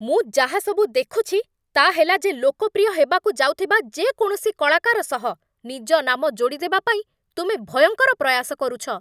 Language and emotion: Odia, angry